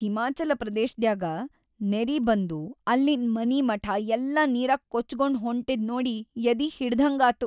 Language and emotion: Kannada, sad